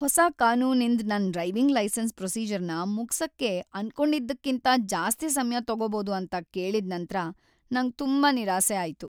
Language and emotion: Kannada, sad